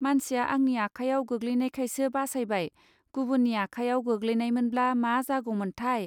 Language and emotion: Bodo, neutral